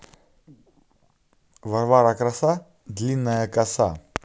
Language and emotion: Russian, neutral